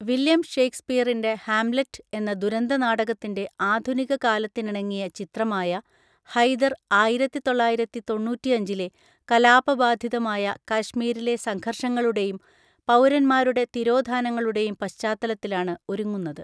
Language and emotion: Malayalam, neutral